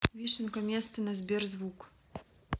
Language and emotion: Russian, neutral